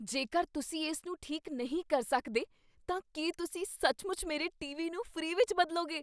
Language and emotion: Punjabi, surprised